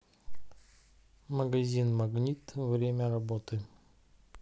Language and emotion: Russian, neutral